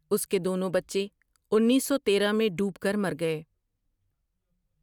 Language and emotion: Urdu, neutral